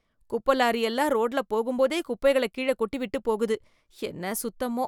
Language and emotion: Tamil, disgusted